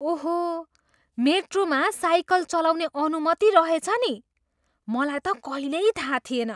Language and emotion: Nepali, surprised